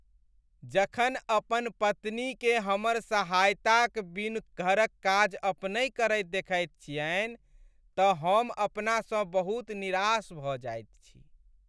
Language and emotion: Maithili, sad